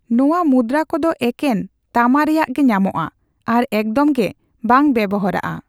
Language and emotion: Santali, neutral